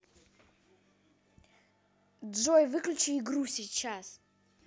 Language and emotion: Russian, angry